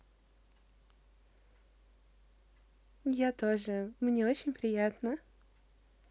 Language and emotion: Russian, positive